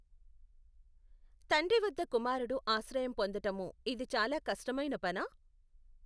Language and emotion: Telugu, neutral